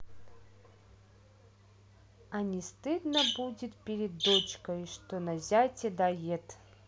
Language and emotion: Russian, neutral